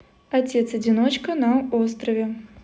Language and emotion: Russian, neutral